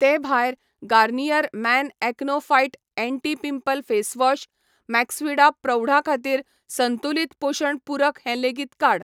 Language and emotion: Goan Konkani, neutral